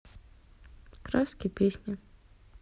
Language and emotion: Russian, neutral